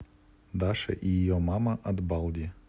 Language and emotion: Russian, neutral